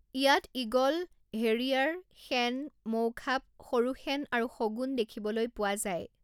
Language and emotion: Assamese, neutral